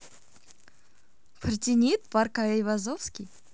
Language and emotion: Russian, positive